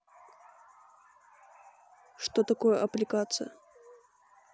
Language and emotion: Russian, neutral